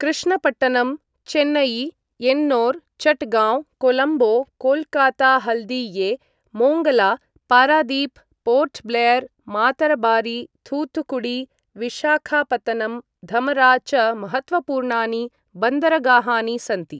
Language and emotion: Sanskrit, neutral